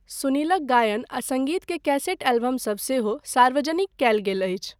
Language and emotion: Maithili, neutral